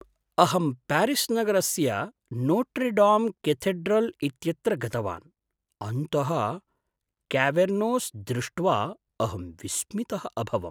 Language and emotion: Sanskrit, surprised